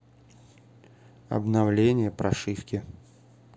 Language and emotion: Russian, neutral